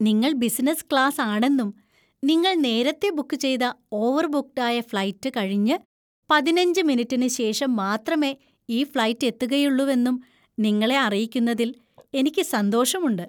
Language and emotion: Malayalam, happy